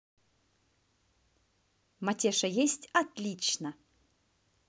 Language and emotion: Russian, positive